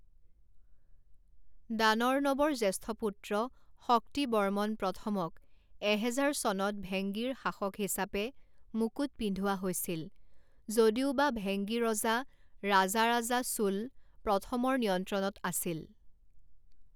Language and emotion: Assamese, neutral